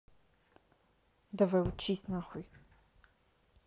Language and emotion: Russian, angry